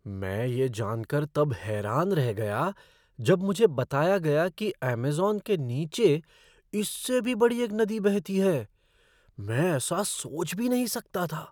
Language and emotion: Hindi, surprised